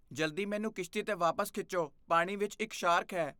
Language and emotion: Punjabi, fearful